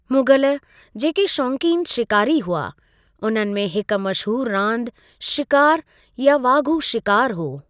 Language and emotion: Sindhi, neutral